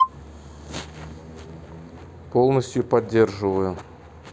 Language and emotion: Russian, neutral